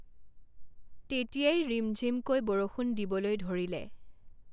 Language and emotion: Assamese, neutral